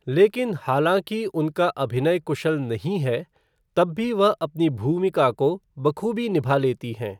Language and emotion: Hindi, neutral